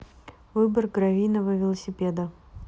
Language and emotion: Russian, neutral